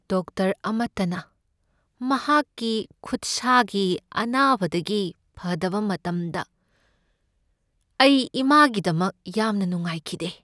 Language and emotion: Manipuri, sad